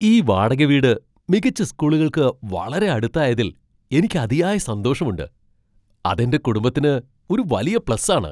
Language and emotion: Malayalam, surprised